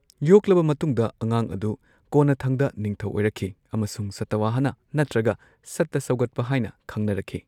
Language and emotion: Manipuri, neutral